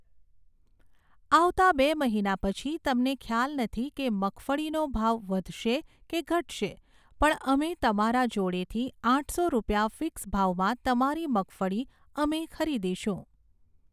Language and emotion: Gujarati, neutral